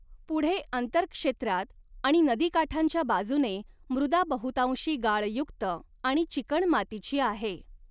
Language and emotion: Marathi, neutral